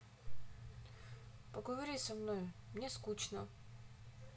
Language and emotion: Russian, sad